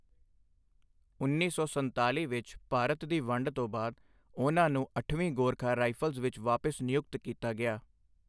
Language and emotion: Punjabi, neutral